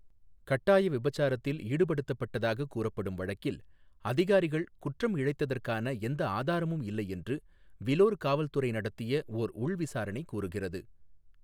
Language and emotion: Tamil, neutral